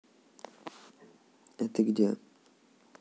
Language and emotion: Russian, neutral